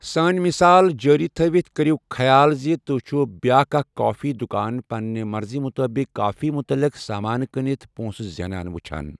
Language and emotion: Kashmiri, neutral